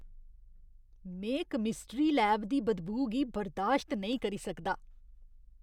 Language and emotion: Dogri, disgusted